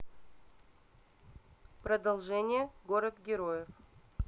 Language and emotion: Russian, neutral